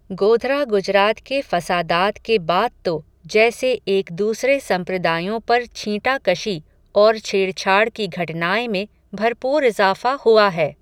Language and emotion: Hindi, neutral